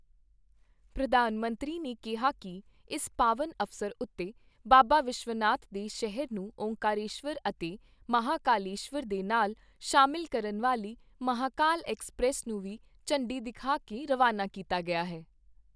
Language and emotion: Punjabi, neutral